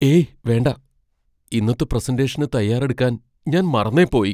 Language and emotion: Malayalam, fearful